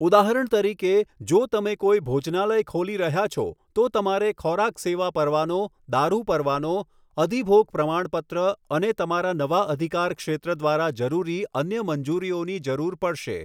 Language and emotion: Gujarati, neutral